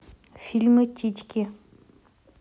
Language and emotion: Russian, neutral